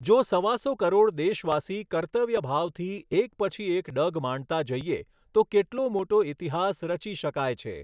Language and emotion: Gujarati, neutral